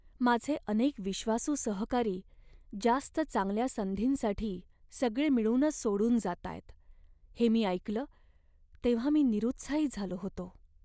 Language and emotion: Marathi, sad